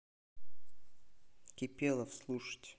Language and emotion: Russian, neutral